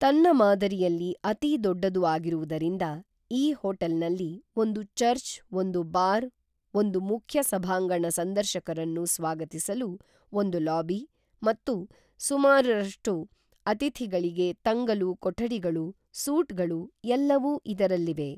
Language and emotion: Kannada, neutral